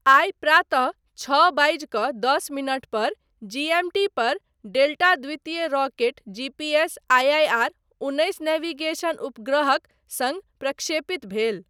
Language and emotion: Maithili, neutral